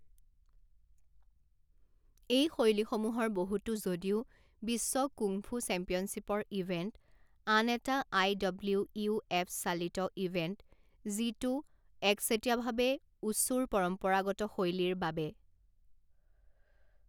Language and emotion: Assamese, neutral